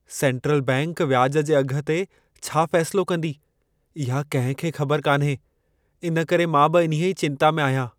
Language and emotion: Sindhi, fearful